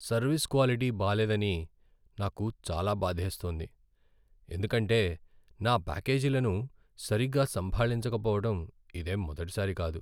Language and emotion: Telugu, sad